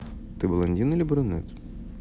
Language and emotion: Russian, neutral